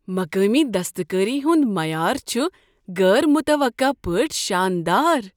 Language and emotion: Kashmiri, surprised